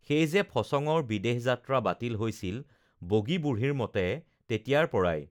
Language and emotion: Assamese, neutral